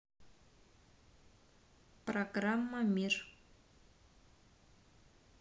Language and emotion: Russian, neutral